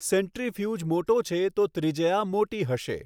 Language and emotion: Gujarati, neutral